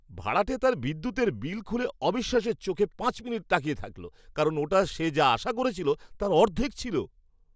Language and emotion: Bengali, surprised